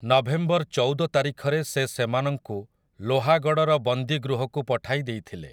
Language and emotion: Odia, neutral